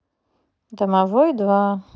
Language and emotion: Russian, neutral